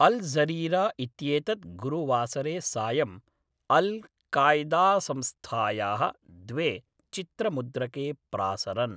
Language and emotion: Sanskrit, neutral